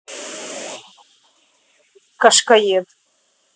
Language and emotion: Russian, angry